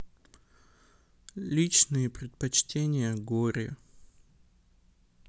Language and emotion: Russian, sad